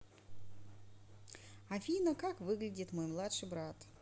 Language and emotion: Russian, positive